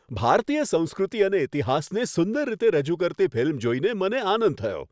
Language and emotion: Gujarati, happy